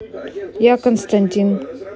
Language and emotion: Russian, neutral